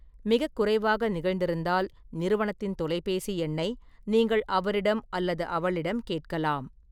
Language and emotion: Tamil, neutral